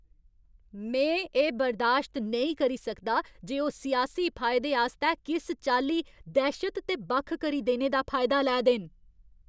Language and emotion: Dogri, angry